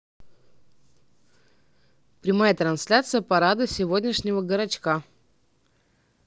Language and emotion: Russian, neutral